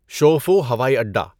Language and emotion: Urdu, neutral